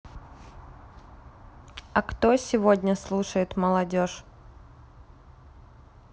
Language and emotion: Russian, neutral